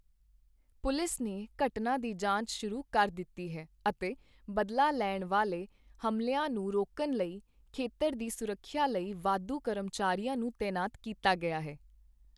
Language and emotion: Punjabi, neutral